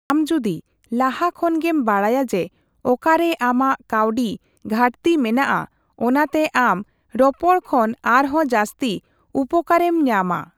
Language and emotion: Santali, neutral